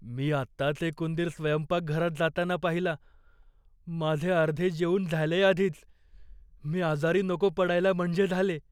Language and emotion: Marathi, fearful